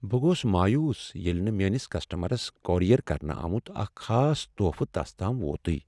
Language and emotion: Kashmiri, sad